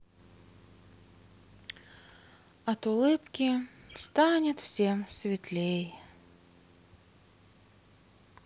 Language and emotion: Russian, sad